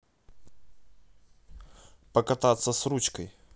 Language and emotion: Russian, neutral